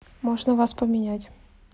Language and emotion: Russian, neutral